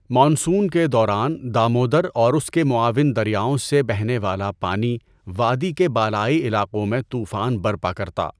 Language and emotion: Urdu, neutral